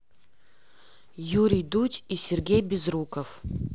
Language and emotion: Russian, neutral